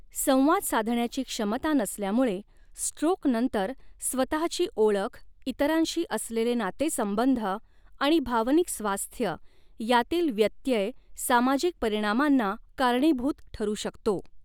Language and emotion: Marathi, neutral